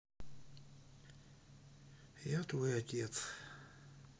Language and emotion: Russian, sad